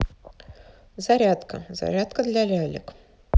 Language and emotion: Russian, neutral